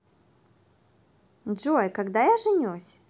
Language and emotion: Russian, positive